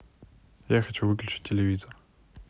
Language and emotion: Russian, neutral